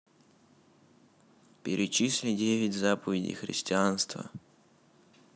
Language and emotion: Russian, neutral